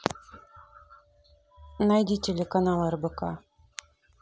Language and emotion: Russian, neutral